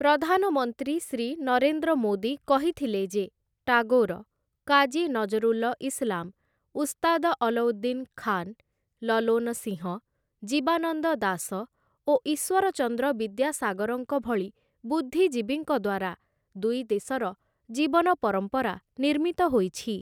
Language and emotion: Odia, neutral